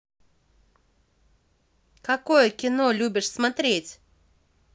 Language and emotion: Russian, positive